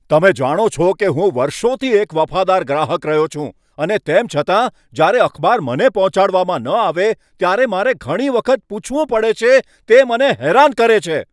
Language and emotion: Gujarati, angry